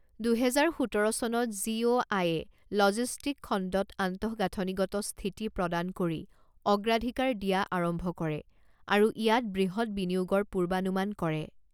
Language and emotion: Assamese, neutral